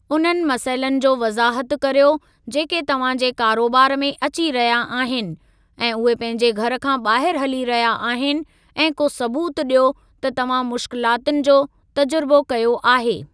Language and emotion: Sindhi, neutral